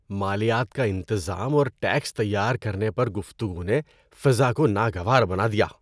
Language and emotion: Urdu, disgusted